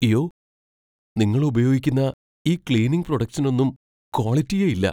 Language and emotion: Malayalam, fearful